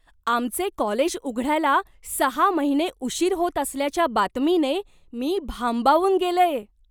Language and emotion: Marathi, surprised